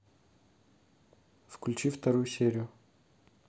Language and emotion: Russian, neutral